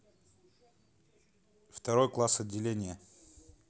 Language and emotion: Russian, neutral